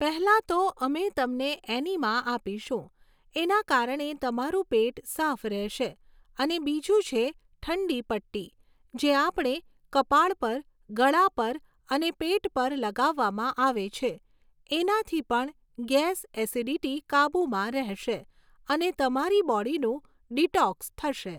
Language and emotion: Gujarati, neutral